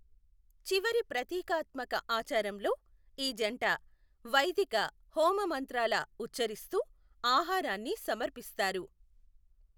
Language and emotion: Telugu, neutral